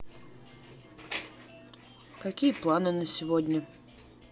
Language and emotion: Russian, neutral